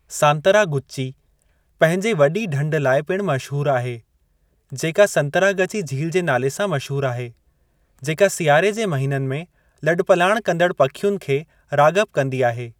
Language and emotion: Sindhi, neutral